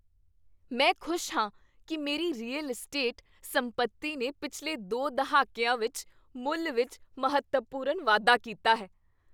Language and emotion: Punjabi, happy